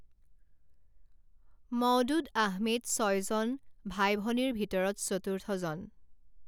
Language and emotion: Assamese, neutral